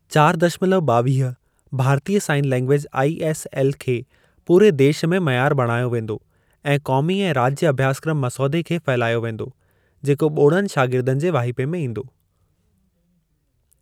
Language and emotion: Sindhi, neutral